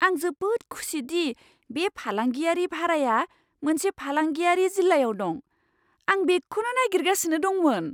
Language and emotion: Bodo, surprised